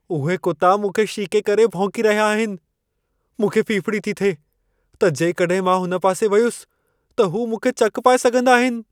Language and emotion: Sindhi, fearful